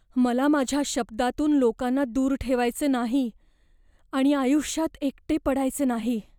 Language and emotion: Marathi, fearful